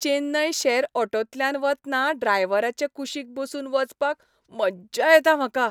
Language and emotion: Goan Konkani, happy